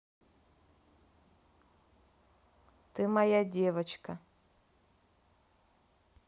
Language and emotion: Russian, neutral